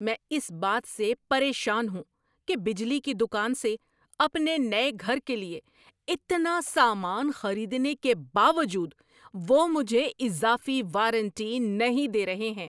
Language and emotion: Urdu, angry